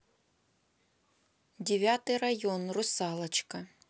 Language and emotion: Russian, neutral